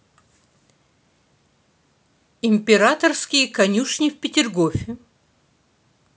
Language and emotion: Russian, neutral